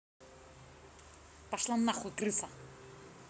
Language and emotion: Russian, angry